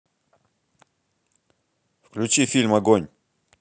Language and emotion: Russian, angry